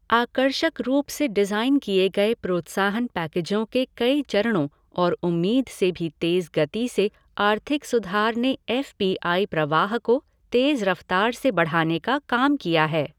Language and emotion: Hindi, neutral